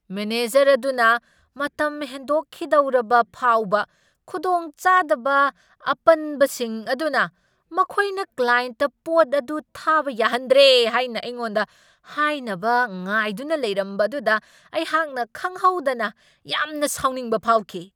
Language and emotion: Manipuri, angry